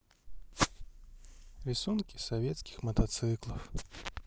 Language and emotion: Russian, sad